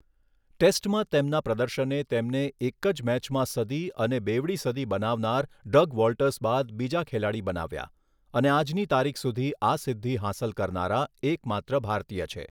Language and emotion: Gujarati, neutral